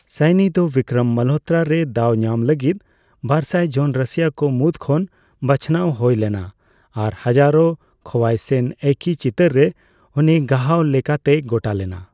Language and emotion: Santali, neutral